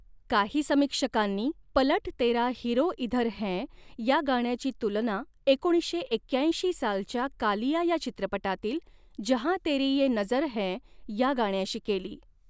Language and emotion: Marathi, neutral